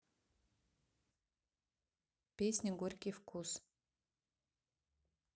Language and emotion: Russian, neutral